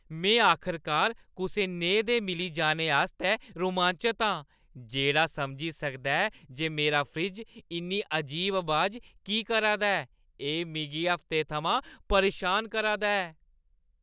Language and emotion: Dogri, happy